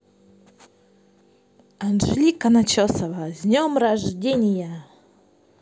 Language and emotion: Russian, positive